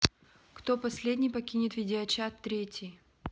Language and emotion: Russian, neutral